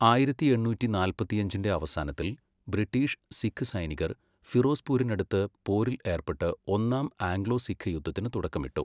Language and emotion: Malayalam, neutral